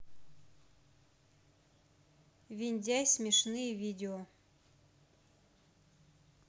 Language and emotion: Russian, neutral